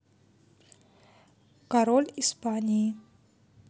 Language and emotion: Russian, neutral